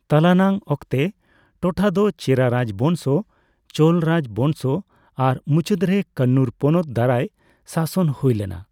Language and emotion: Santali, neutral